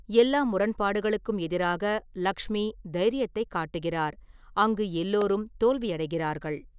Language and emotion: Tamil, neutral